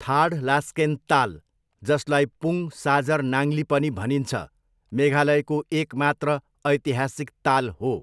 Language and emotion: Nepali, neutral